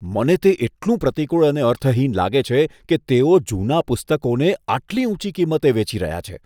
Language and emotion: Gujarati, disgusted